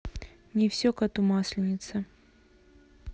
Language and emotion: Russian, neutral